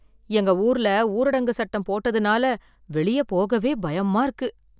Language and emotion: Tamil, fearful